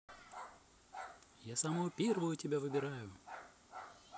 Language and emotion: Russian, positive